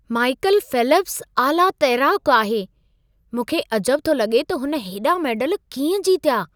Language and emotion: Sindhi, surprised